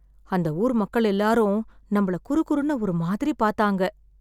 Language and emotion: Tamil, sad